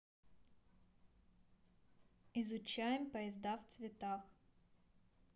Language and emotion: Russian, neutral